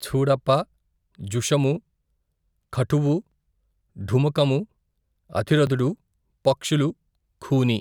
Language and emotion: Telugu, neutral